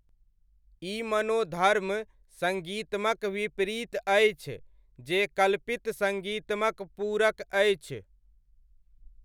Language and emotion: Maithili, neutral